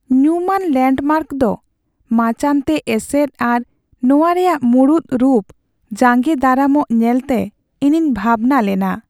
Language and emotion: Santali, sad